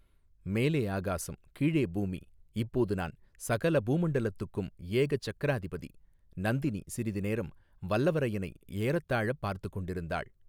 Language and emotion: Tamil, neutral